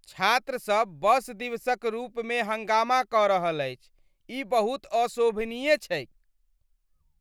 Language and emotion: Maithili, disgusted